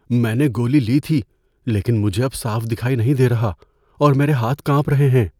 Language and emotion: Urdu, fearful